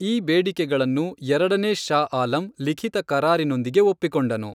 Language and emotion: Kannada, neutral